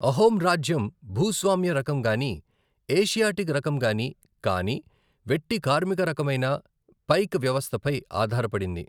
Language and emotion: Telugu, neutral